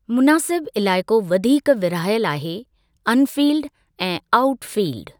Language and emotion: Sindhi, neutral